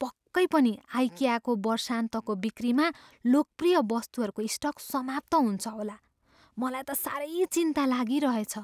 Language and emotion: Nepali, fearful